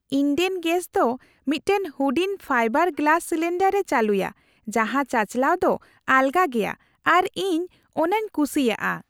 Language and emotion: Santali, happy